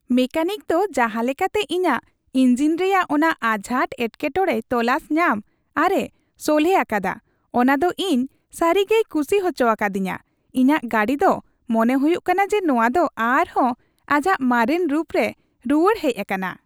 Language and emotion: Santali, happy